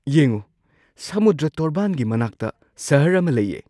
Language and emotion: Manipuri, surprised